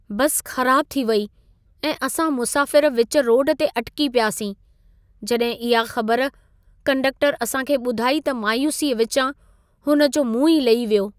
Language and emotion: Sindhi, sad